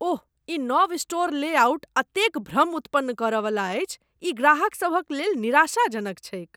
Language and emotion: Maithili, disgusted